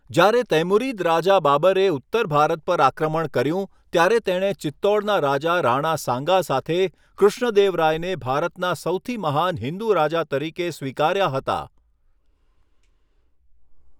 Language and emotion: Gujarati, neutral